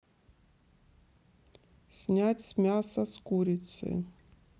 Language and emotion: Russian, neutral